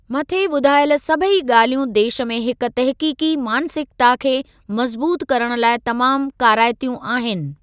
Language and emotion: Sindhi, neutral